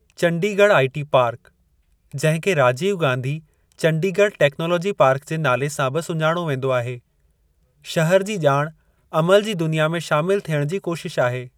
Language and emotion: Sindhi, neutral